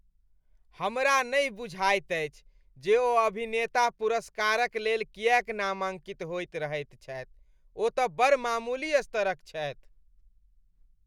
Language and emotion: Maithili, disgusted